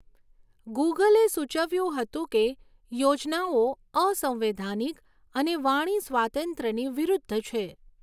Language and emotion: Gujarati, neutral